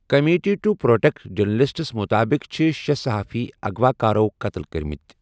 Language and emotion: Kashmiri, neutral